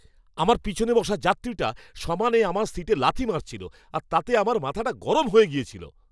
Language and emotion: Bengali, angry